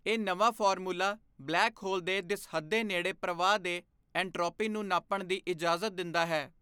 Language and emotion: Punjabi, neutral